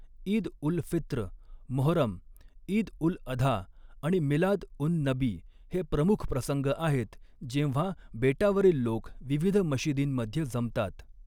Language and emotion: Marathi, neutral